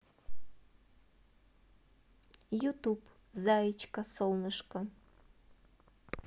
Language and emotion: Russian, neutral